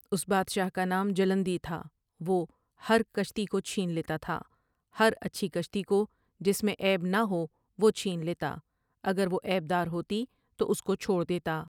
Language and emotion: Urdu, neutral